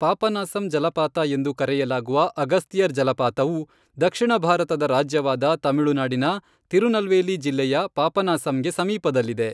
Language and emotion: Kannada, neutral